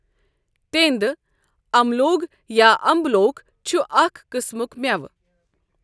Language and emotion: Kashmiri, neutral